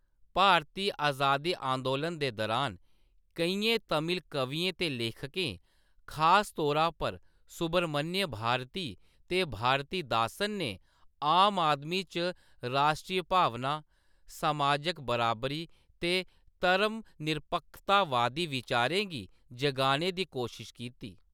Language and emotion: Dogri, neutral